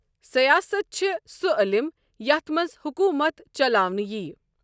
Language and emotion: Kashmiri, neutral